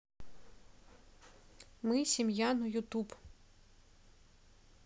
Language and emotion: Russian, neutral